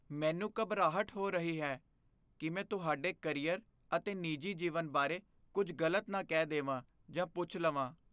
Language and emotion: Punjabi, fearful